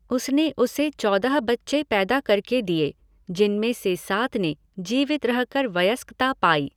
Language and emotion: Hindi, neutral